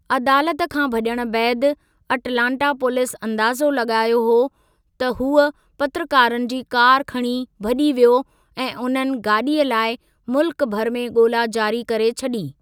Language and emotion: Sindhi, neutral